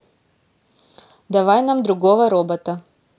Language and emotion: Russian, neutral